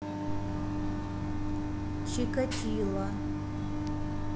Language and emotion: Russian, neutral